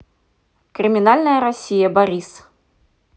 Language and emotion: Russian, neutral